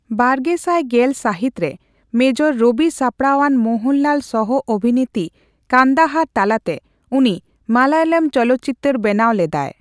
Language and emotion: Santali, neutral